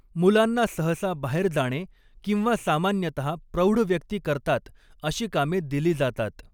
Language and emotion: Marathi, neutral